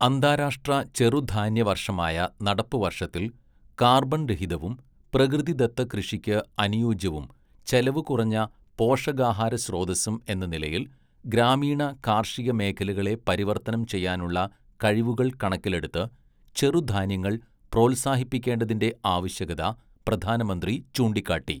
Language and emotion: Malayalam, neutral